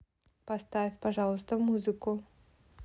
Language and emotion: Russian, neutral